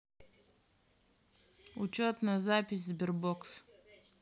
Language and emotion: Russian, neutral